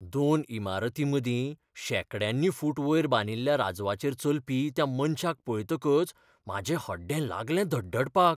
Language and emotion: Goan Konkani, fearful